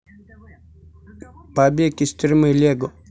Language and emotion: Russian, neutral